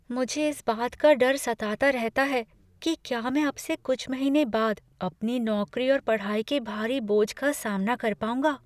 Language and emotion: Hindi, fearful